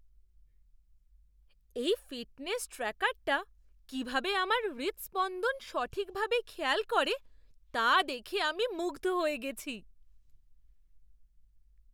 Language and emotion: Bengali, surprised